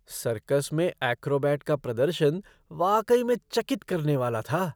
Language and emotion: Hindi, surprised